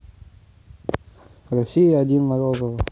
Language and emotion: Russian, neutral